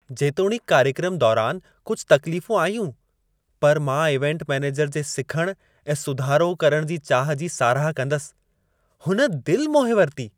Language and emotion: Sindhi, happy